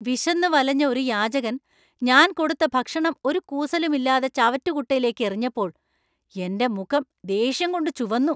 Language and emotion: Malayalam, angry